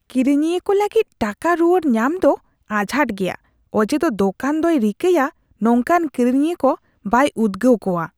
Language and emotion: Santali, disgusted